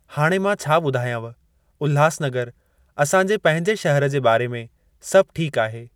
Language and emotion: Sindhi, neutral